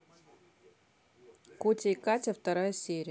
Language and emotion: Russian, neutral